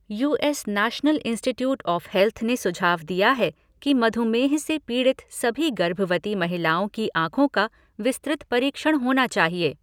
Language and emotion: Hindi, neutral